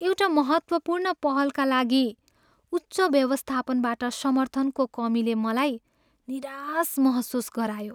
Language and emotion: Nepali, sad